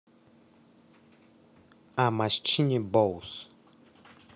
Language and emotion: Russian, neutral